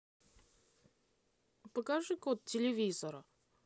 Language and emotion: Russian, neutral